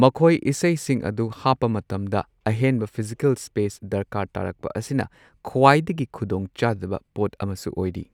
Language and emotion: Manipuri, neutral